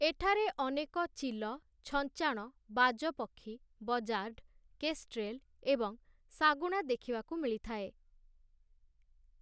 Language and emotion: Odia, neutral